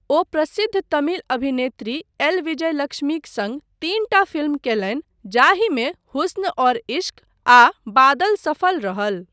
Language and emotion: Maithili, neutral